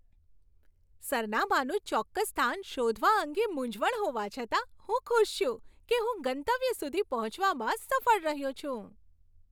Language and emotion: Gujarati, happy